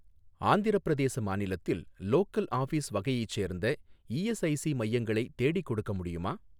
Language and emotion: Tamil, neutral